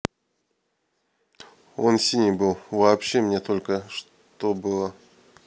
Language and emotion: Russian, neutral